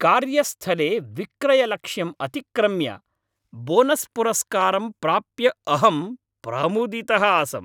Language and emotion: Sanskrit, happy